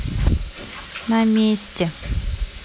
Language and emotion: Russian, neutral